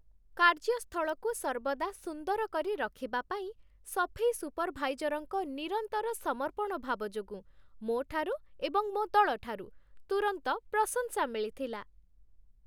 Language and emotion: Odia, happy